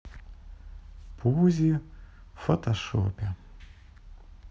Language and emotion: Russian, sad